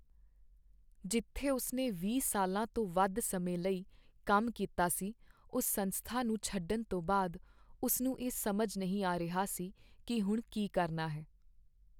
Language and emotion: Punjabi, sad